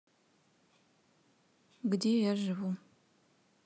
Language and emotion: Russian, neutral